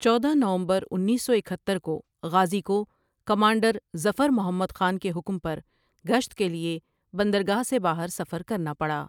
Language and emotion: Urdu, neutral